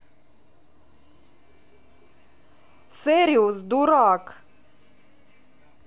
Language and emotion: Russian, angry